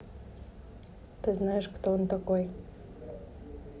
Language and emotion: Russian, neutral